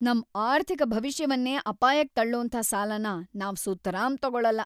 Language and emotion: Kannada, angry